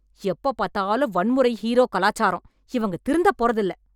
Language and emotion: Tamil, angry